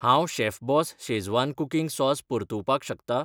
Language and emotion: Goan Konkani, neutral